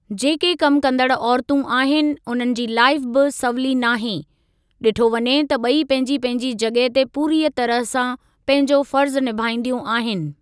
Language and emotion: Sindhi, neutral